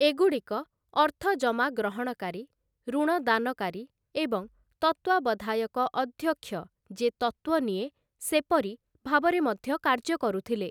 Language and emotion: Odia, neutral